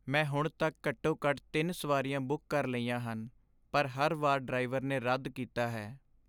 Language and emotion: Punjabi, sad